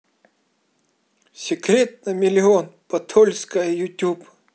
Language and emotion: Russian, positive